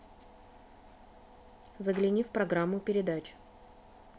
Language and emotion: Russian, neutral